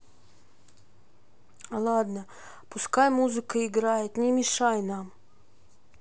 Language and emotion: Russian, sad